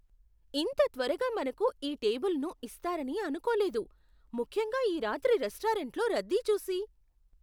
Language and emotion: Telugu, surprised